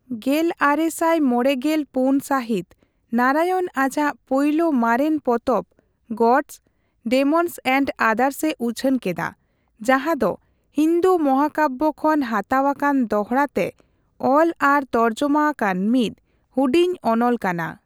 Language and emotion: Santali, neutral